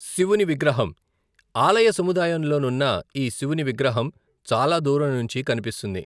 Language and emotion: Telugu, neutral